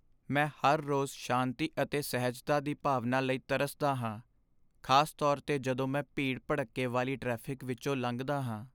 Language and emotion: Punjabi, sad